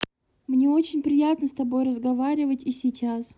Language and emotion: Russian, positive